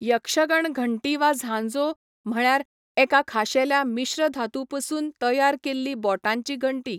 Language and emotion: Goan Konkani, neutral